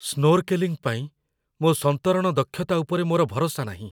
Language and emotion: Odia, fearful